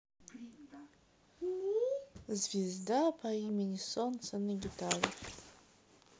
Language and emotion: Russian, sad